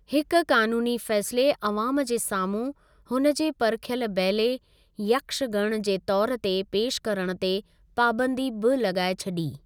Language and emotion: Sindhi, neutral